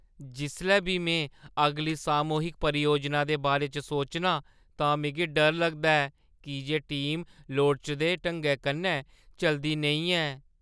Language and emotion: Dogri, fearful